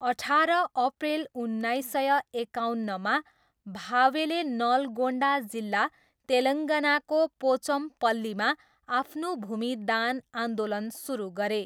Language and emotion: Nepali, neutral